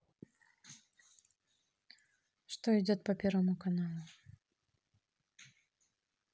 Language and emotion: Russian, neutral